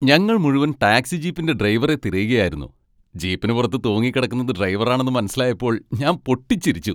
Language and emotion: Malayalam, happy